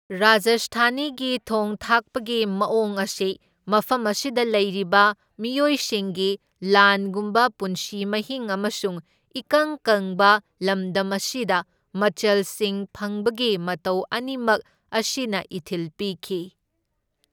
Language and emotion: Manipuri, neutral